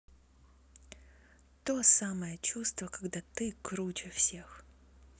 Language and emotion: Russian, neutral